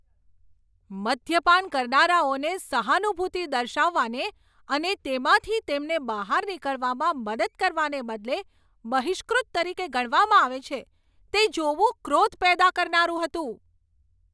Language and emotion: Gujarati, angry